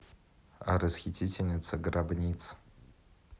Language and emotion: Russian, neutral